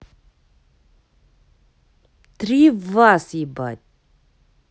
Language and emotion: Russian, angry